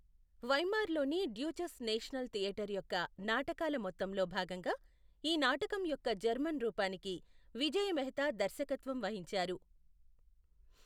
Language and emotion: Telugu, neutral